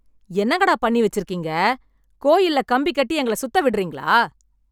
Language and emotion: Tamil, angry